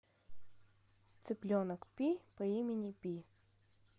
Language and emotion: Russian, neutral